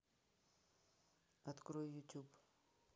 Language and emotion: Russian, neutral